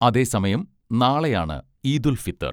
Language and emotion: Malayalam, neutral